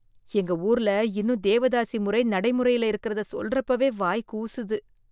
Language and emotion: Tamil, disgusted